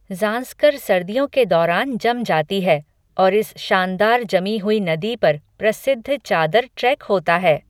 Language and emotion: Hindi, neutral